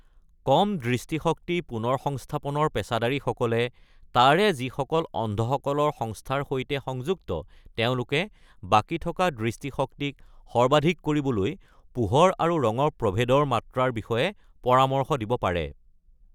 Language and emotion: Assamese, neutral